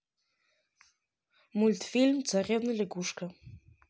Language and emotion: Russian, neutral